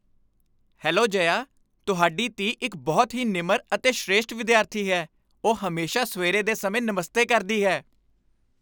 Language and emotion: Punjabi, happy